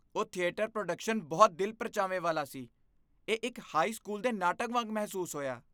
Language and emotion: Punjabi, disgusted